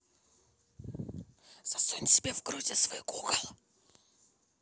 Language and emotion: Russian, angry